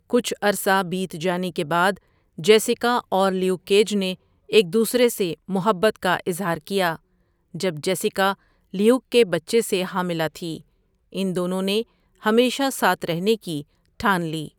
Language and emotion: Urdu, neutral